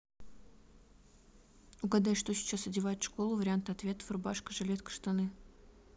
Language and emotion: Russian, neutral